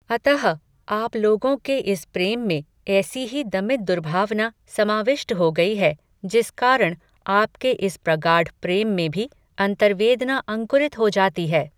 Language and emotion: Hindi, neutral